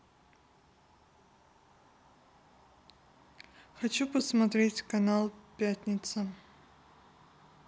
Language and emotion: Russian, neutral